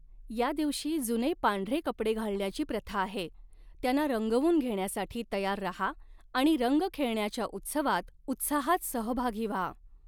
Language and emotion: Marathi, neutral